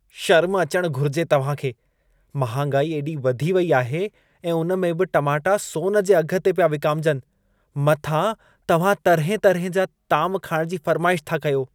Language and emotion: Sindhi, disgusted